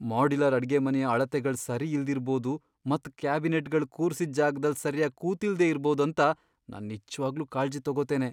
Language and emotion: Kannada, fearful